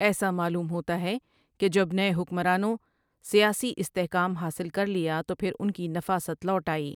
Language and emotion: Urdu, neutral